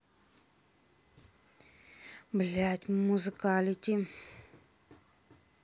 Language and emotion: Russian, angry